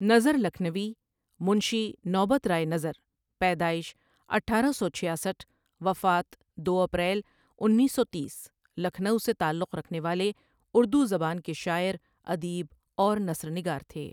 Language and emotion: Urdu, neutral